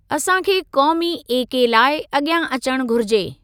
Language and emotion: Sindhi, neutral